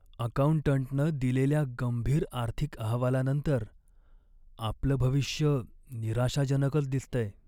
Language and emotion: Marathi, sad